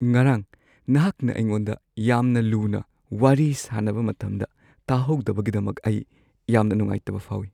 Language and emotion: Manipuri, sad